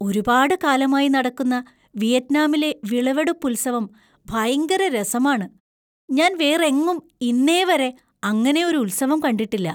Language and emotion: Malayalam, surprised